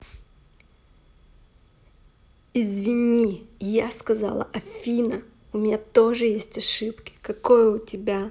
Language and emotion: Russian, angry